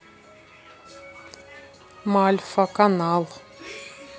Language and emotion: Russian, neutral